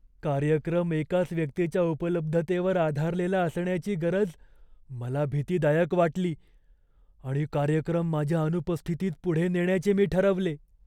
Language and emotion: Marathi, fearful